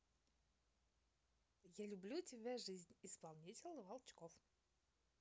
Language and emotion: Russian, positive